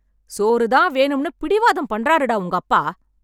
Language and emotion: Tamil, angry